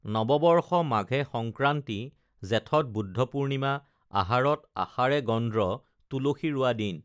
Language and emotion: Assamese, neutral